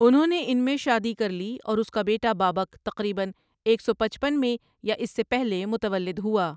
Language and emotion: Urdu, neutral